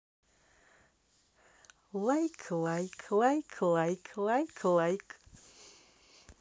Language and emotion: Russian, positive